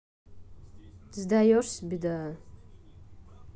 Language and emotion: Russian, neutral